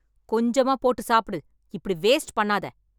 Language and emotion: Tamil, angry